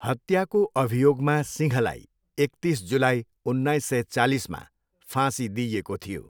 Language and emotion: Nepali, neutral